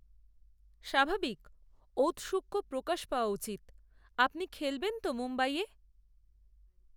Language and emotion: Bengali, neutral